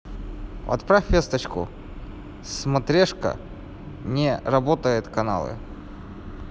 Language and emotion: Russian, neutral